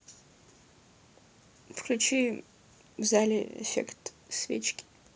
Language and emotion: Russian, neutral